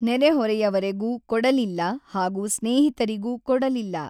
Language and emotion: Kannada, neutral